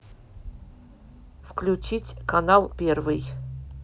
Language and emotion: Russian, neutral